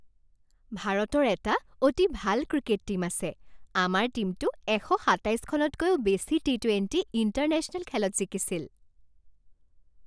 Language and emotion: Assamese, happy